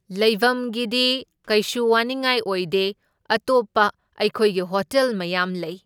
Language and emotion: Manipuri, neutral